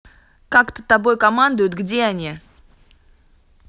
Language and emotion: Russian, angry